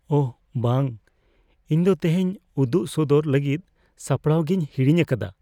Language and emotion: Santali, fearful